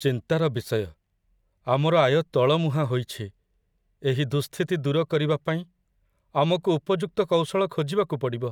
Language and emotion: Odia, sad